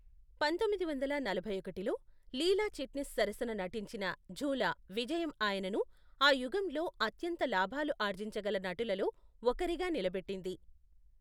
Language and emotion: Telugu, neutral